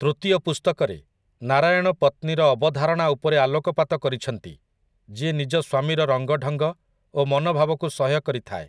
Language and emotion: Odia, neutral